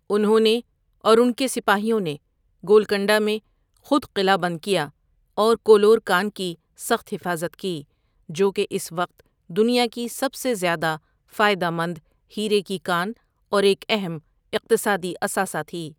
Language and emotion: Urdu, neutral